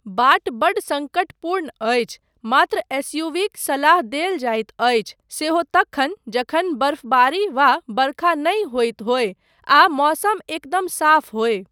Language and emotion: Maithili, neutral